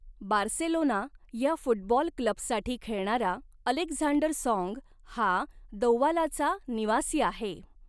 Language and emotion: Marathi, neutral